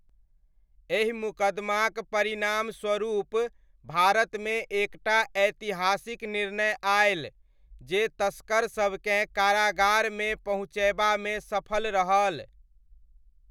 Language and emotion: Maithili, neutral